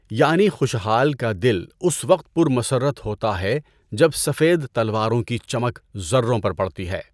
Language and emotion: Urdu, neutral